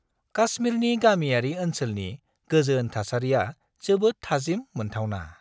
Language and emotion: Bodo, happy